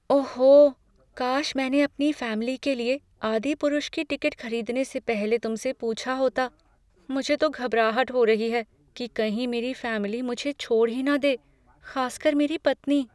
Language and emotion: Hindi, fearful